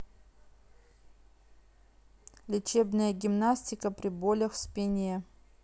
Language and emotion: Russian, neutral